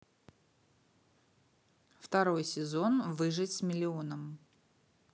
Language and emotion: Russian, neutral